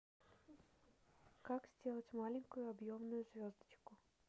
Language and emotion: Russian, neutral